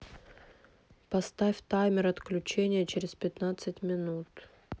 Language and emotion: Russian, neutral